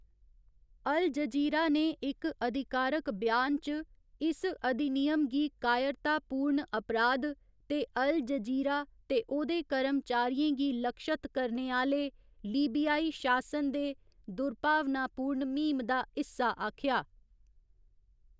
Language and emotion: Dogri, neutral